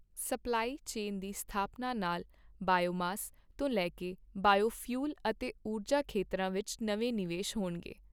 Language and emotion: Punjabi, neutral